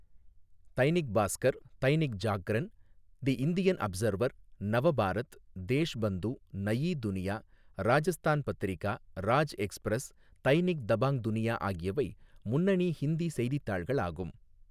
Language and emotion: Tamil, neutral